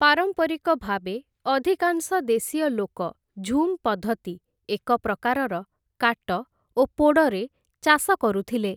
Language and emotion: Odia, neutral